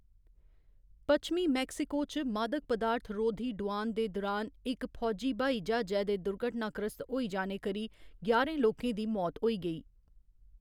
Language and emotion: Dogri, neutral